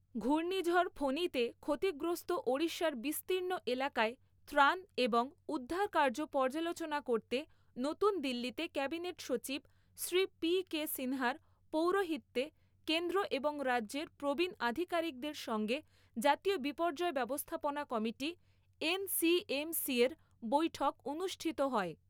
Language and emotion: Bengali, neutral